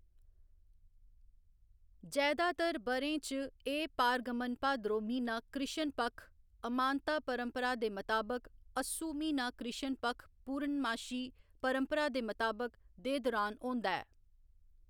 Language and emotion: Dogri, neutral